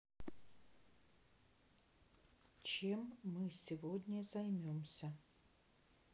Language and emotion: Russian, neutral